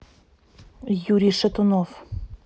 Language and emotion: Russian, neutral